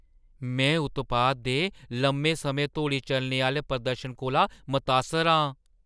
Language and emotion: Dogri, surprised